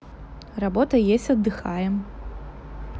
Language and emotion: Russian, neutral